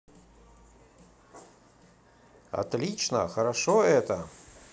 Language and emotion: Russian, positive